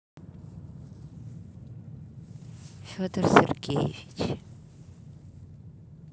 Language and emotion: Russian, neutral